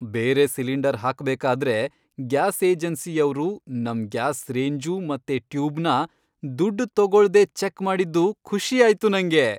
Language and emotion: Kannada, happy